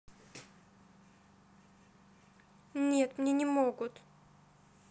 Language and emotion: Russian, sad